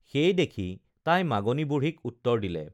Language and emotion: Assamese, neutral